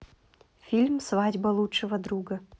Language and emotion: Russian, neutral